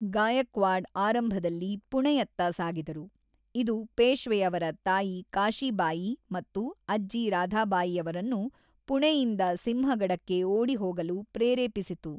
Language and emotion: Kannada, neutral